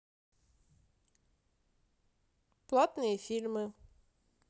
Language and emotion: Russian, neutral